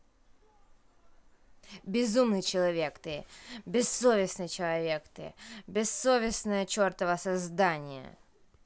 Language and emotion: Russian, angry